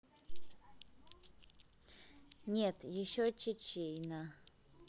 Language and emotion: Russian, neutral